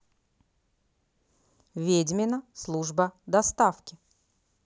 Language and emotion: Russian, neutral